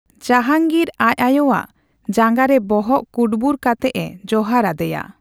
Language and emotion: Santali, neutral